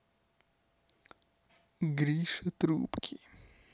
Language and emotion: Russian, neutral